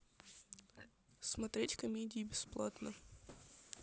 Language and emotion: Russian, neutral